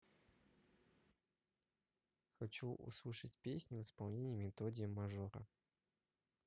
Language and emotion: Russian, neutral